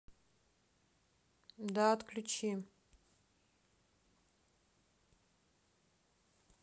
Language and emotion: Russian, neutral